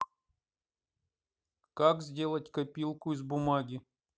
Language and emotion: Russian, neutral